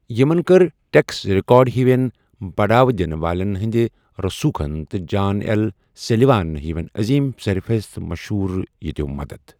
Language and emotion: Kashmiri, neutral